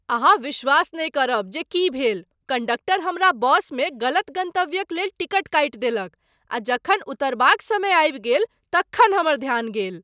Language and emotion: Maithili, surprised